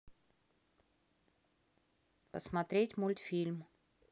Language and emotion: Russian, neutral